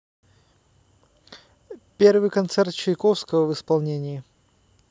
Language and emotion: Russian, neutral